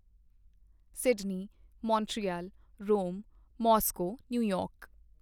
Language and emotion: Punjabi, neutral